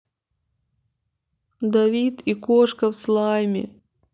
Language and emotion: Russian, sad